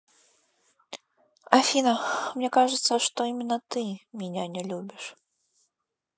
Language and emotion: Russian, sad